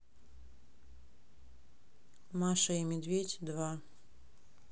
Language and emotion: Russian, neutral